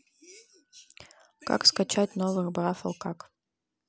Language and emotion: Russian, neutral